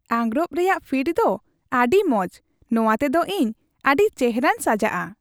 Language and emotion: Santali, happy